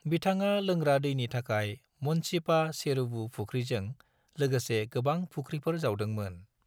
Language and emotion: Bodo, neutral